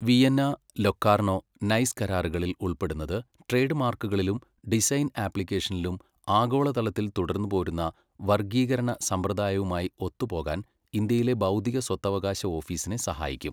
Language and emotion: Malayalam, neutral